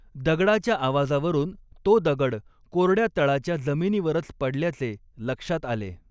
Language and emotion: Marathi, neutral